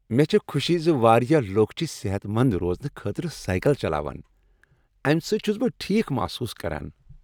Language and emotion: Kashmiri, happy